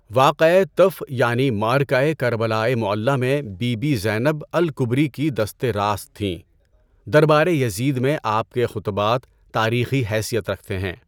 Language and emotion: Urdu, neutral